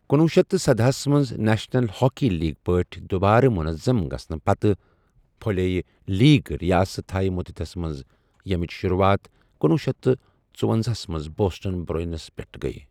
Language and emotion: Kashmiri, neutral